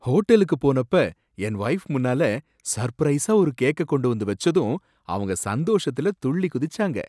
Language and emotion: Tamil, surprised